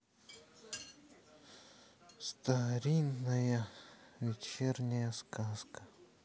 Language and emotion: Russian, sad